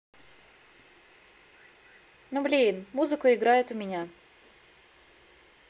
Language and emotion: Russian, sad